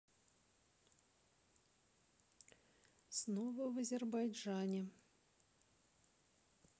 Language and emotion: Russian, neutral